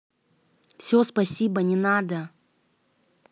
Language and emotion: Russian, angry